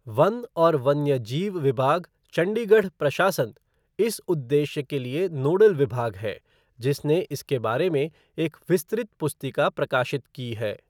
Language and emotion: Hindi, neutral